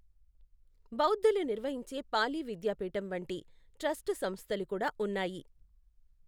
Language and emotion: Telugu, neutral